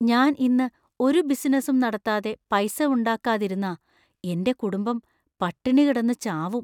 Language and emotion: Malayalam, fearful